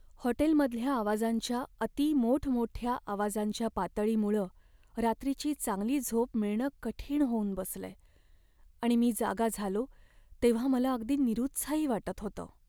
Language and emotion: Marathi, sad